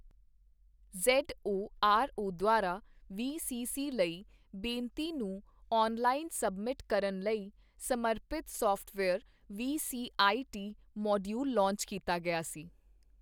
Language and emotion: Punjabi, neutral